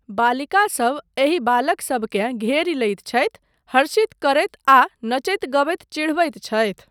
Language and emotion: Maithili, neutral